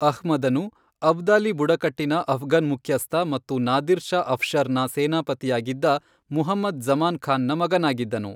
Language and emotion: Kannada, neutral